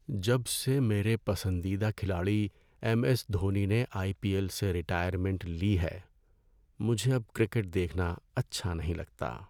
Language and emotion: Urdu, sad